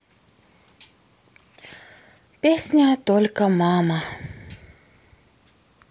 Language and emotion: Russian, sad